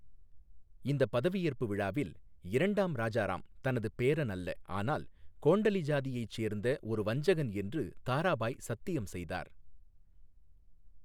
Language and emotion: Tamil, neutral